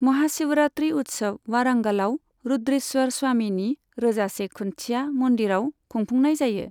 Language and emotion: Bodo, neutral